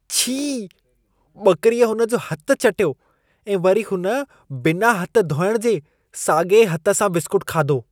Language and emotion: Sindhi, disgusted